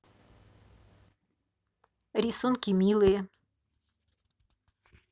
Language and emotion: Russian, neutral